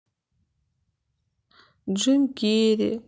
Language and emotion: Russian, sad